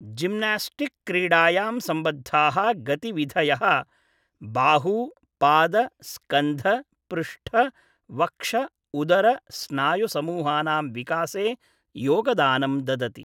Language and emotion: Sanskrit, neutral